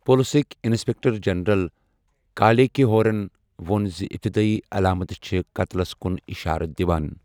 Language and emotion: Kashmiri, neutral